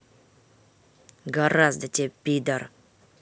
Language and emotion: Russian, angry